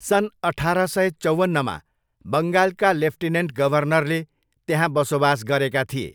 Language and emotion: Nepali, neutral